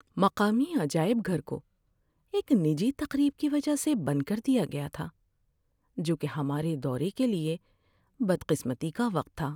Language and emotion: Urdu, sad